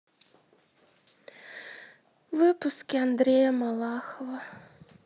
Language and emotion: Russian, sad